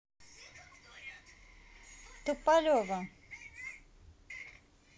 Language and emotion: Russian, neutral